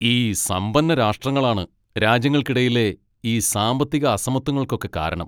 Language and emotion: Malayalam, angry